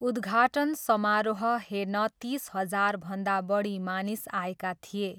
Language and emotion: Nepali, neutral